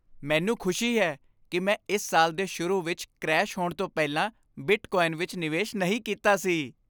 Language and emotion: Punjabi, happy